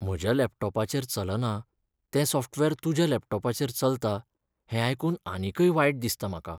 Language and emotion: Goan Konkani, sad